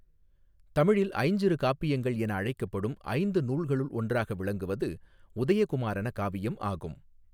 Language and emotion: Tamil, neutral